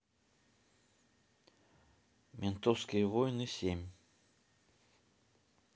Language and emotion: Russian, neutral